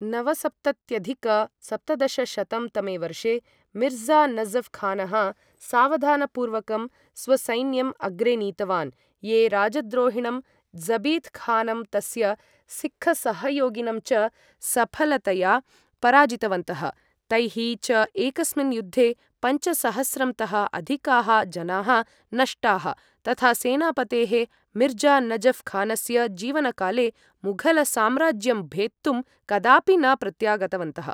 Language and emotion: Sanskrit, neutral